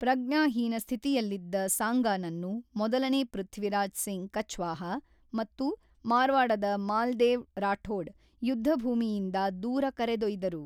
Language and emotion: Kannada, neutral